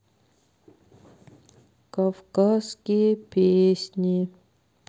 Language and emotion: Russian, sad